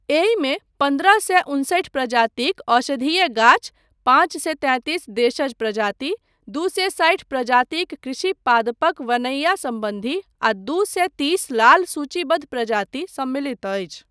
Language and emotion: Maithili, neutral